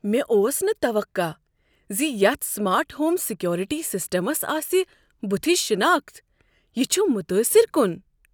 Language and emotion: Kashmiri, surprised